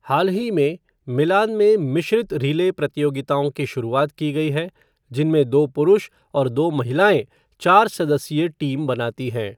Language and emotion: Hindi, neutral